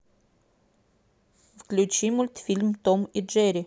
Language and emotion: Russian, neutral